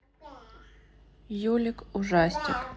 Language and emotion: Russian, neutral